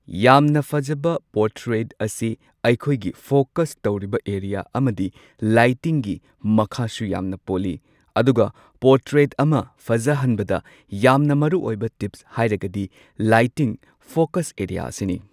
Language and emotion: Manipuri, neutral